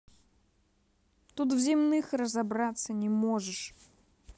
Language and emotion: Russian, angry